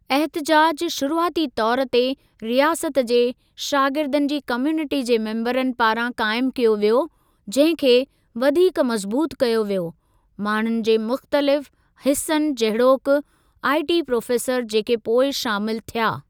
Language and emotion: Sindhi, neutral